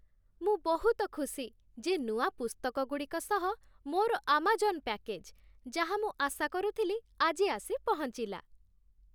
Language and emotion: Odia, happy